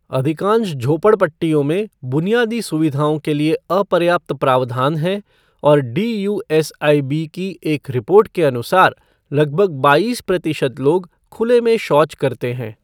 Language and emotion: Hindi, neutral